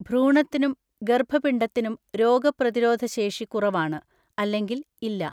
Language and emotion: Malayalam, neutral